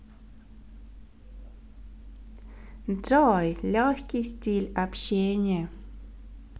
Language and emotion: Russian, positive